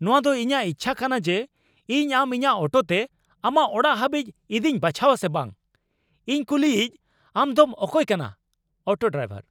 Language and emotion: Santali, angry